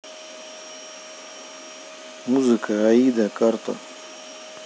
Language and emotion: Russian, neutral